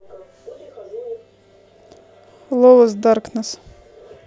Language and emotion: Russian, neutral